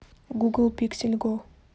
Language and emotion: Russian, neutral